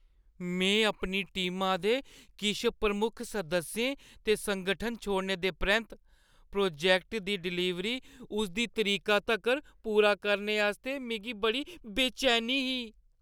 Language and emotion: Dogri, fearful